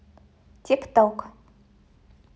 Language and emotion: Russian, neutral